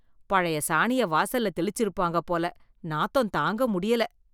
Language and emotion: Tamil, disgusted